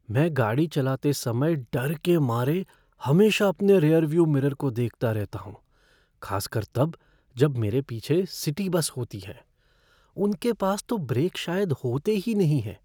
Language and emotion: Hindi, fearful